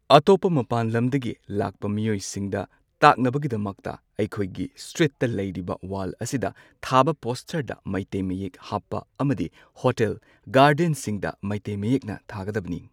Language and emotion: Manipuri, neutral